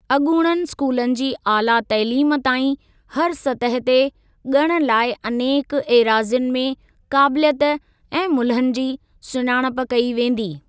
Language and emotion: Sindhi, neutral